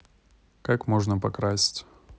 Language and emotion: Russian, neutral